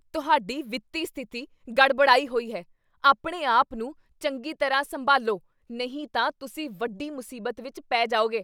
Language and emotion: Punjabi, angry